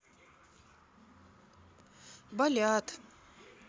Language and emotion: Russian, sad